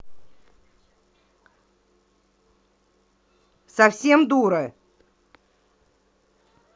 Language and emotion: Russian, angry